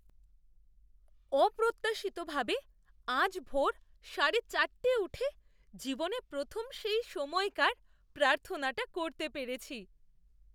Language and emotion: Bengali, surprised